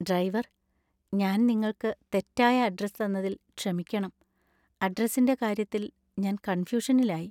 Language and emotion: Malayalam, sad